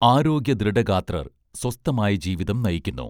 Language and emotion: Malayalam, neutral